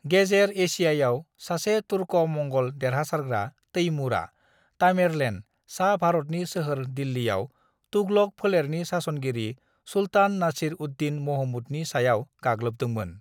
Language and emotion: Bodo, neutral